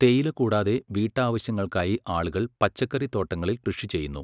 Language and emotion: Malayalam, neutral